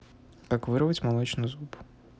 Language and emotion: Russian, neutral